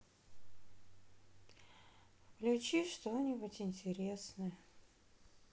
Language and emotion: Russian, sad